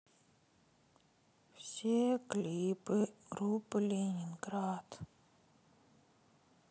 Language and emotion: Russian, sad